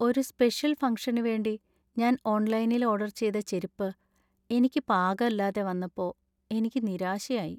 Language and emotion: Malayalam, sad